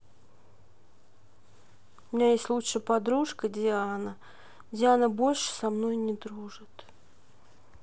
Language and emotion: Russian, sad